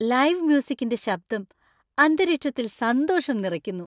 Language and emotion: Malayalam, happy